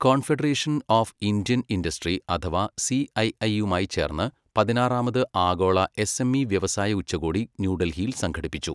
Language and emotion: Malayalam, neutral